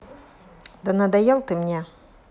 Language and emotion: Russian, angry